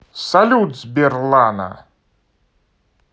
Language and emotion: Russian, positive